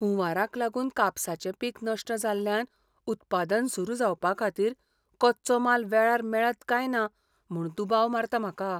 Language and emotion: Goan Konkani, fearful